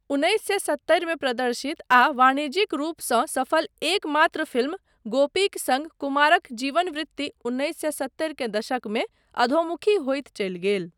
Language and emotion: Maithili, neutral